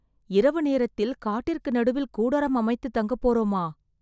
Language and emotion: Tamil, fearful